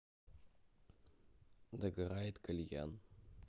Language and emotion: Russian, neutral